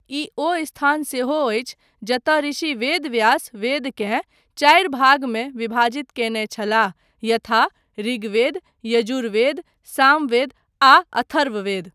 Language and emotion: Maithili, neutral